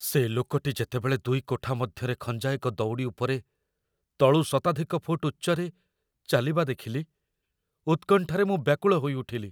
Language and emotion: Odia, fearful